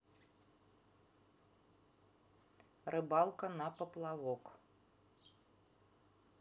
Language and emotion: Russian, neutral